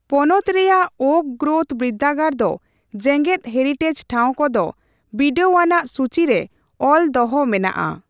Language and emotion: Santali, neutral